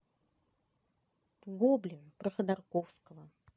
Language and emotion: Russian, neutral